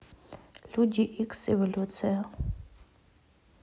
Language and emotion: Russian, neutral